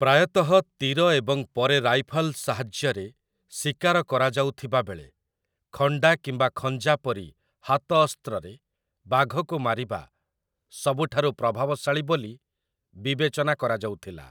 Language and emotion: Odia, neutral